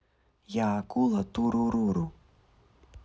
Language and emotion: Russian, neutral